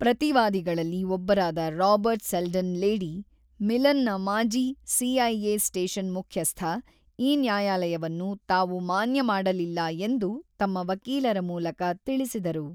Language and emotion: Kannada, neutral